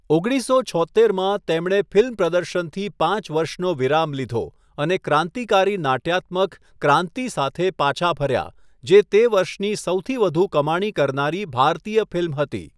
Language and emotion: Gujarati, neutral